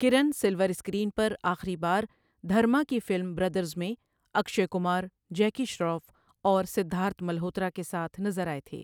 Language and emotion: Urdu, neutral